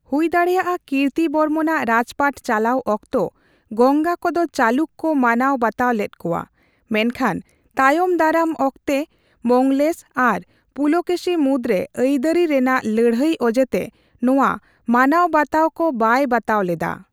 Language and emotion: Santali, neutral